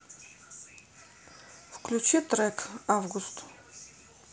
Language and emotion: Russian, neutral